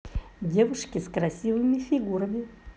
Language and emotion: Russian, positive